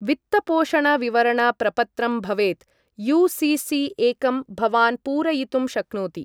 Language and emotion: Sanskrit, neutral